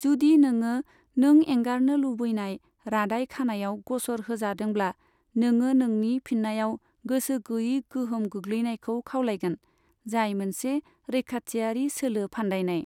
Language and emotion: Bodo, neutral